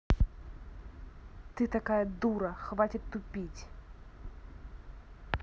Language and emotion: Russian, angry